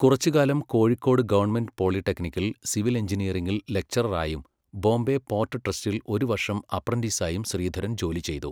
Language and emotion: Malayalam, neutral